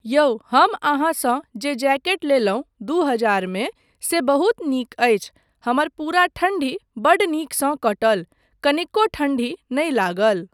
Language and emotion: Maithili, neutral